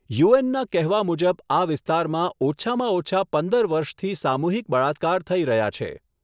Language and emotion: Gujarati, neutral